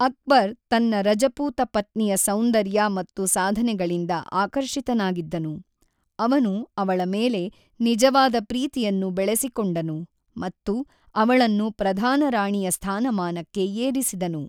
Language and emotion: Kannada, neutral